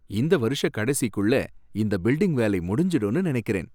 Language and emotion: Tamil, happy